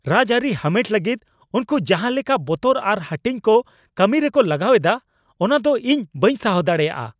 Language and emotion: Santali, angry